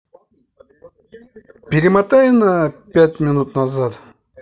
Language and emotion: Russian, neutral